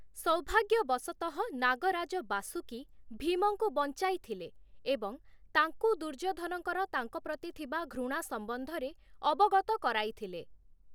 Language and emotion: Odia, neutral